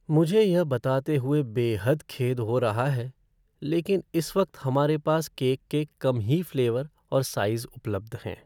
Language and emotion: Hindi, sad